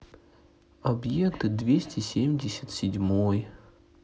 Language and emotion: Russian, sad